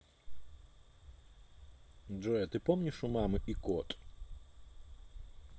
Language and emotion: Russian, neutral